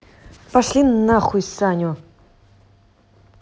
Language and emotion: Russian, angry